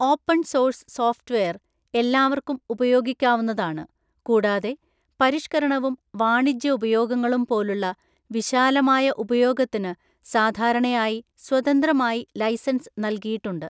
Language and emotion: Malayalam, neutral